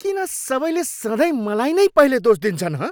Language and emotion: Nepali, angry